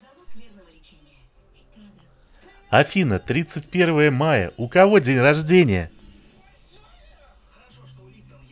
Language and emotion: Russian, positive